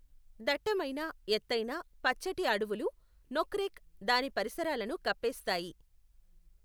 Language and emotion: Telugu, neutral